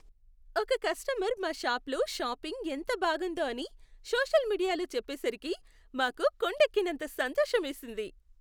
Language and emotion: Telugu, happy